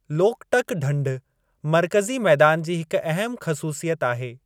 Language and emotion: Sindhi, neutral